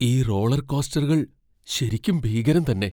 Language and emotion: Malayalam, fearful